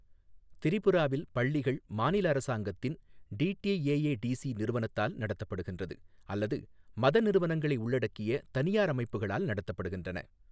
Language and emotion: Tamil, neutral